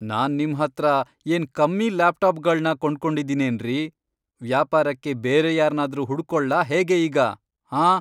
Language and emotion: Kannada, angry